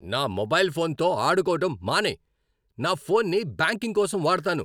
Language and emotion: Telugu, angry